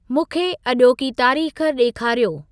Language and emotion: Sindhi, neutral